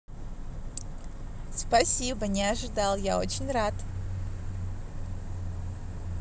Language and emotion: Russian, positive